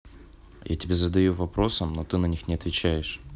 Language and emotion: Russian, neutral